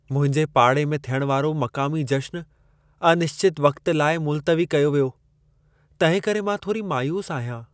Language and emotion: Sindhi, sad